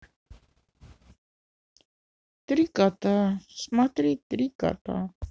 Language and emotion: Russian, sad